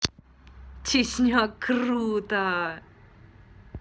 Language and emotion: Russian, positive